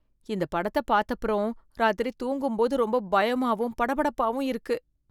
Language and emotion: Tamil, fearful